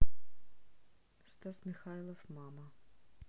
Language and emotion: Russian, neutral